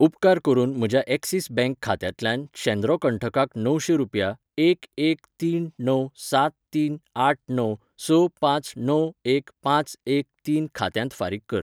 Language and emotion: Goan Konkani, neutral